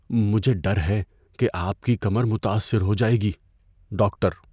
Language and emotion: Urdu, fearful